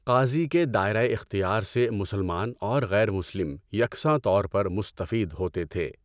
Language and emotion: Urdu, neutral